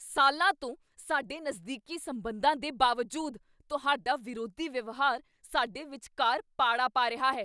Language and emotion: Punjabi, angry